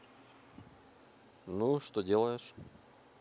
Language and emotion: Russian, neutral